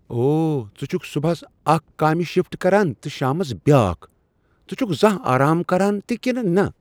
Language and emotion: Kashmiri, surprised